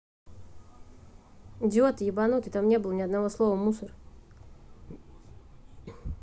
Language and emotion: Russian, angry